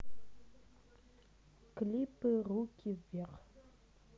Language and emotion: Russian, neutral